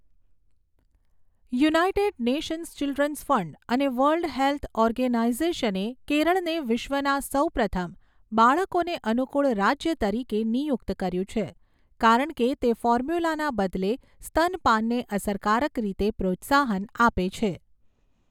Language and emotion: Gujarati, neutral